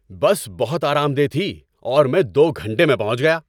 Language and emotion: Urdu, happy